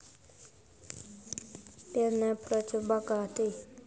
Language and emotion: Russian, neutral